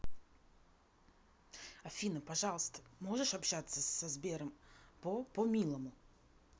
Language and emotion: Russian, angry